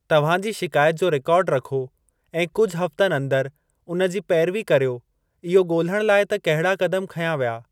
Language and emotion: Sindhi, neutral